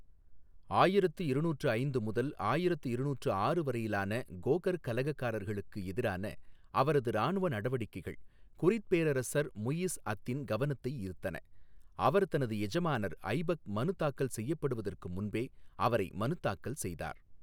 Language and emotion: Tamil, neutral